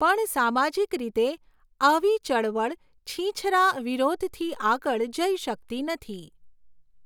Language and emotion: Gujarati, neutral